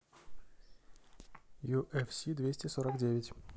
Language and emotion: Russian, neutral